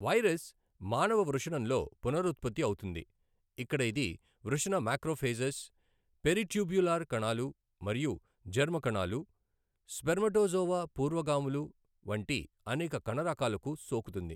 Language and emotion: Telugu, neutral